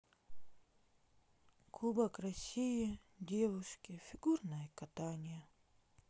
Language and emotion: Russian, sad